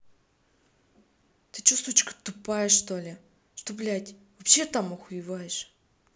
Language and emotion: Russian, angry